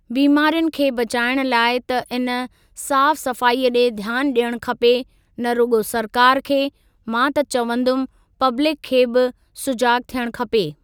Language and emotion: Sindhi, neutral